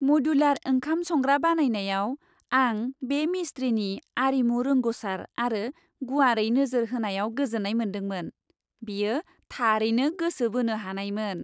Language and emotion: Bodo, happy